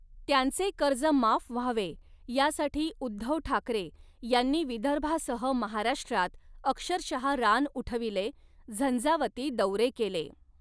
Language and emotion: Marathi, neutral